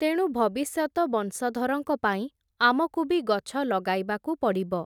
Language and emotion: Odia, neutral